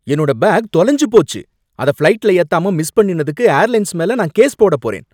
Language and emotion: Tamil, angry